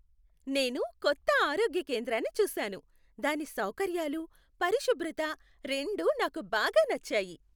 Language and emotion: Telugu, happy